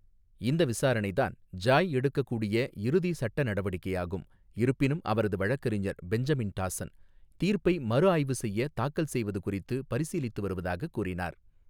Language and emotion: Tamil, neutral